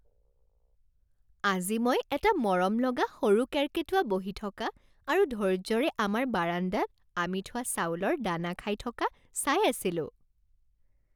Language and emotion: Assamese, happy